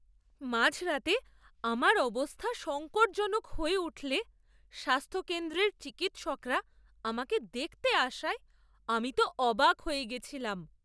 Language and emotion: Bengali, surprised